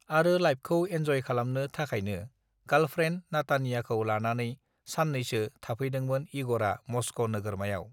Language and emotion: Bodo, neutral